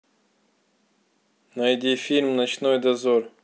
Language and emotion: Russian, neutral